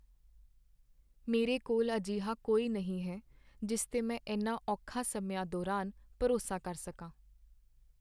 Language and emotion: Punjabi, sad